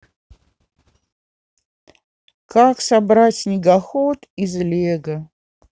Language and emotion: Russian, sad